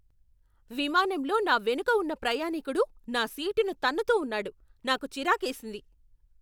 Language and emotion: Telugu, angry